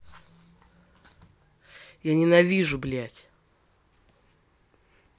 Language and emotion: Russian, angry